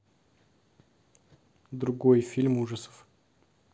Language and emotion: Russian, neutral